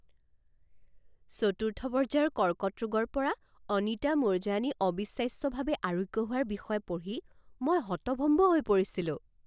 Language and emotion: Assamese, surprised